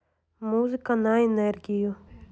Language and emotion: Russian, neutral